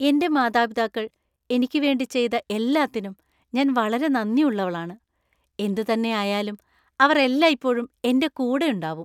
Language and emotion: Malayalam, happy